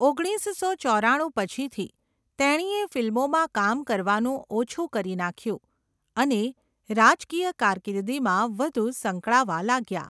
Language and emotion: Gujarati, neutral